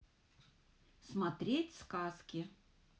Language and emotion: Russian, positive